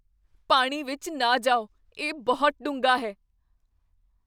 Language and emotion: Punjabi, fearful